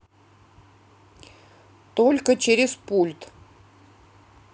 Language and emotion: Russian, neutral